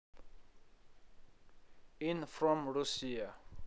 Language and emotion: Russian, neutral